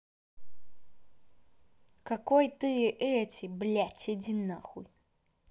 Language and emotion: Russian, angry